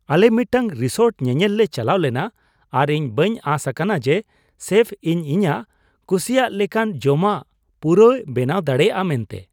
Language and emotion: Santali, surprised